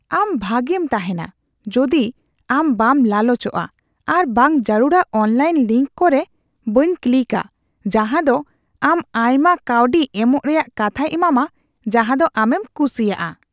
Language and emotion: Santali, disgusted